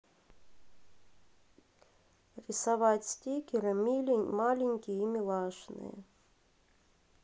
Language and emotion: Russian, neutral